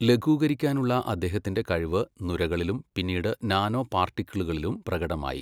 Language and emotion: Malayalam, neutral